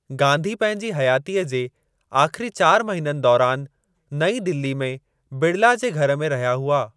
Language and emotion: Sindhi, neutral